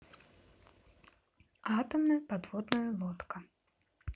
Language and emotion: Russian, neutral